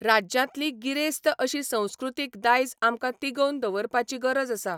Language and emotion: Goan Konkani, neutral